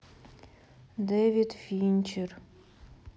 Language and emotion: Russian, sad